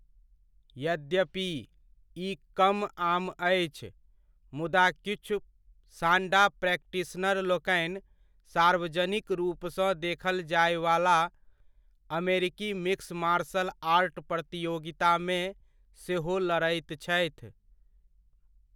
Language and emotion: Maithili, neutral